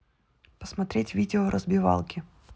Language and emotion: Russian, neutral